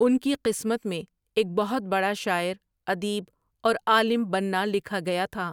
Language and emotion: Urdu, neutral